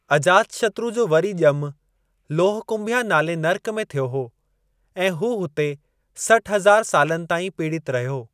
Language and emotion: Sindhi, neutral